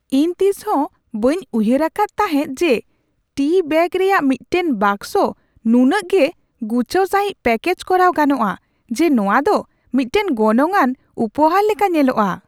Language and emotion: Santali, surprised